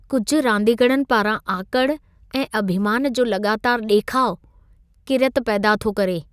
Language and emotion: Sindhi, disgusted